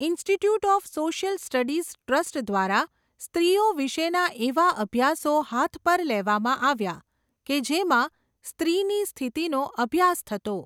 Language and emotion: Gujarati, neutral